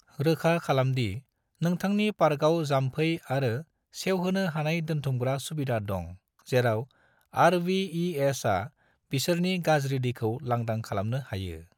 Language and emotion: Bodo, neutral